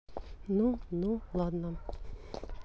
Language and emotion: Russian, neutral